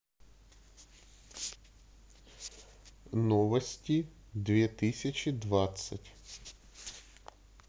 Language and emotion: Russian, neutral